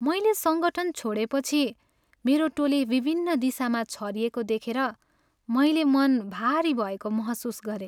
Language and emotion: Nepali, sad